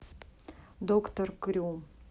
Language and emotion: Russian, neutral